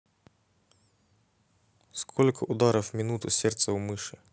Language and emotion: Russian, neutral